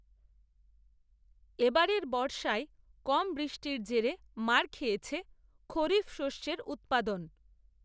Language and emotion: Bengali, neutral